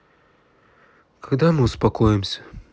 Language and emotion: Russian, sad